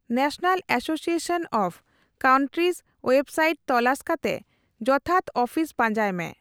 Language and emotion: Santali, neutral